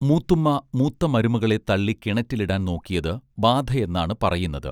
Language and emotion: Malayalam, neutral